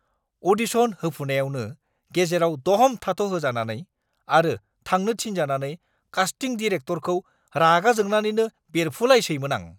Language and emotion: Bodo, angry